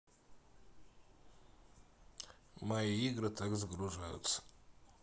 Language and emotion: Russian, neutral